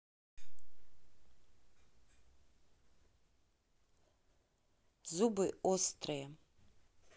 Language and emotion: Russian, neutral